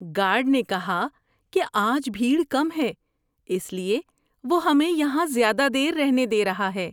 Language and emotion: Urdu, happy